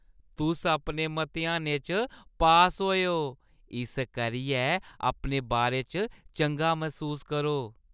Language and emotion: Dogri, happy